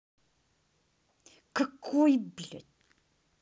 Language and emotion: Russian, angry